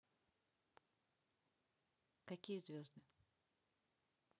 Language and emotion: Russian, neutral